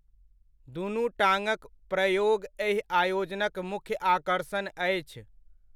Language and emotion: Maithili, neutral